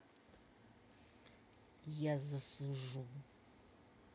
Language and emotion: Russian, neutral